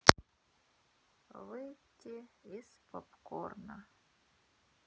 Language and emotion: Russian, sad